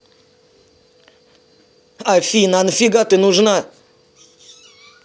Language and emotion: Russian, angry